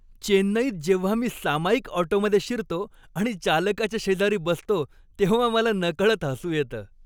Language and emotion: Marathi, happy